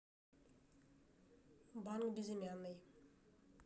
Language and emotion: Russian, neutral